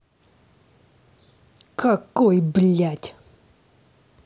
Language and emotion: Russian, angry